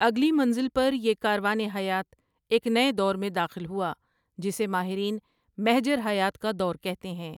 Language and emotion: Urdu, neutral